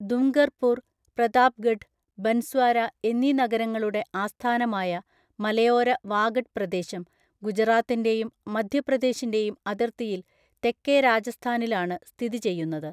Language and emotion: Malayalam, neutral